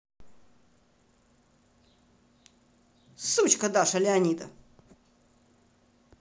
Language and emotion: Russian, angry